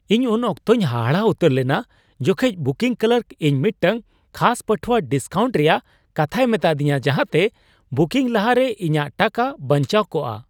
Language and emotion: Santali, surprised